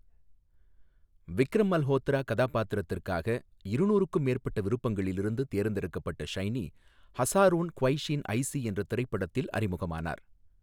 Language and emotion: Tamil, neutral